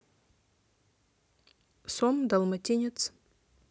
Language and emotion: Russian, neutral